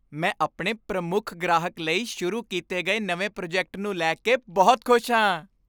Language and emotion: Punjabi, happy